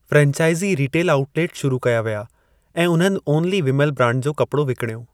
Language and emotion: Sindhi, neutral